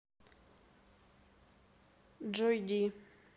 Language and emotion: Russian, neutral